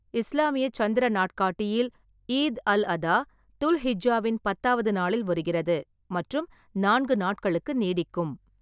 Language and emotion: Tamil, neutral